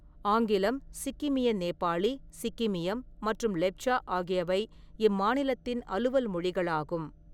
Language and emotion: Tamil, neutral